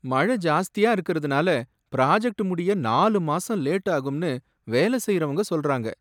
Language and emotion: Tamil, sad